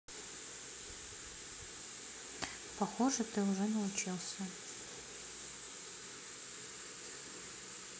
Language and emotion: Russian, neutral